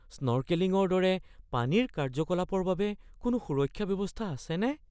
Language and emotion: Assamese, fearful